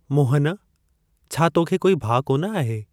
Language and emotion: Sindhi, neutral